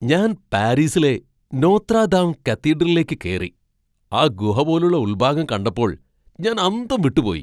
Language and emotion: Malayalam, surprised